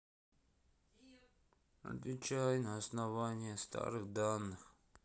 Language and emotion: Russian, sad